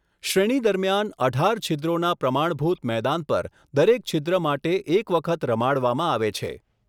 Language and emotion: Gujarati, neutral